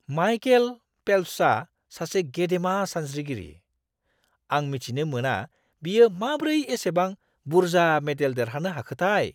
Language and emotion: Bodo, surprised